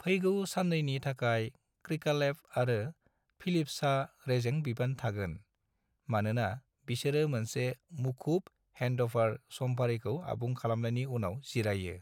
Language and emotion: Bodo, neutral